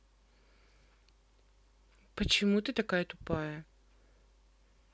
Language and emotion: Russian, angry